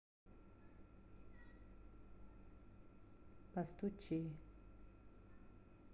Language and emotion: Russian, neutral